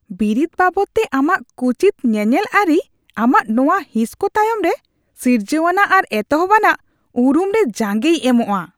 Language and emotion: Santali, disgusted